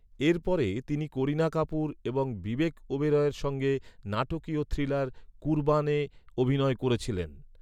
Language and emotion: Bengali, neutral